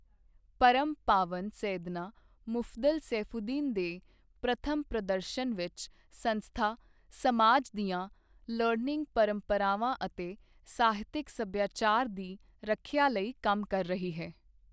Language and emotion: Punjabi, neutral